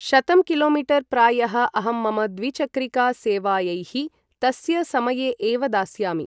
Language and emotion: Sanskrit, neutral